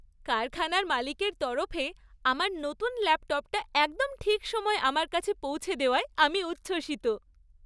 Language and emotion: Bengali, happy